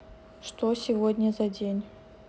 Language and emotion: Russian, neutral